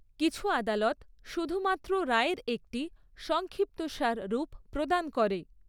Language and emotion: Bengali, neutral